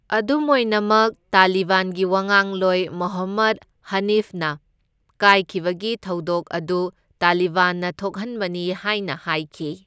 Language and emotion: Manipuri, neutral